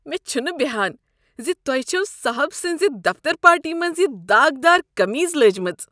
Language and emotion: Kashmiri, disgusted